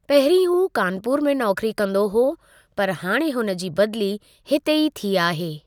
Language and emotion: Sindhi, neutral